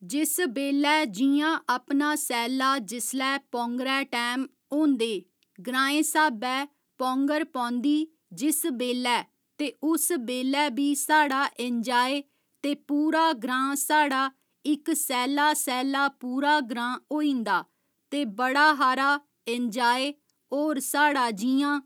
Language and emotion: Dogri, neutral